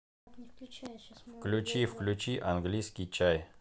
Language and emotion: Russian, neutral